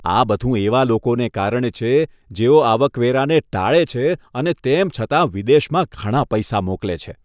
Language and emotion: Gujarati, disgusted